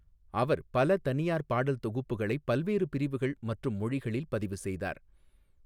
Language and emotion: Tamil, neutral